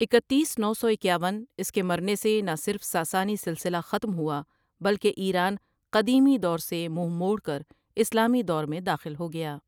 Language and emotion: Urdu, neutral